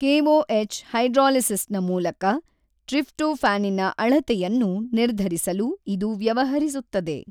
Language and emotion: Kannada, neutral